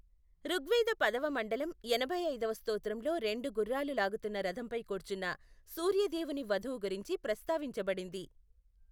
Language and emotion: Telugu, neutral